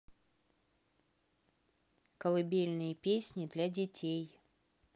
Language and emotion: Russian, neutral